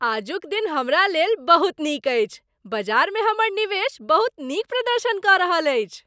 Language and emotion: Maithili, happy